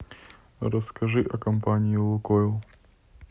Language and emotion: Russian, neutral